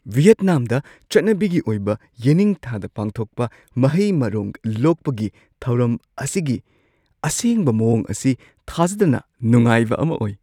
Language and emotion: Manipuri, surprised